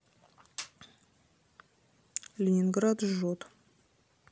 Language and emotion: Russian, neutral